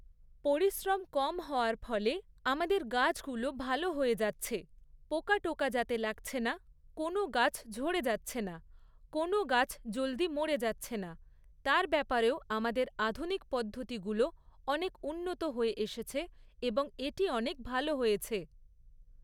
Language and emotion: Bengali, neutral